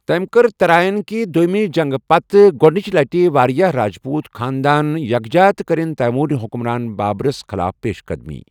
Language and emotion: Kashmiri, neutral